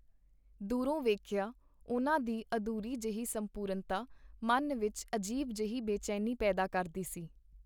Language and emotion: Punjabi, neutral